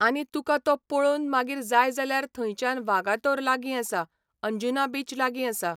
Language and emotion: Goan Konkani, neutral